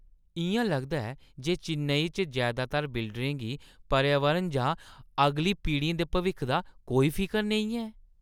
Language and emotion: Dogri, disgusted